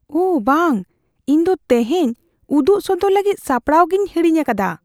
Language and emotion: Santali, fearful